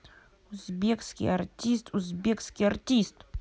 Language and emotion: Russian, angry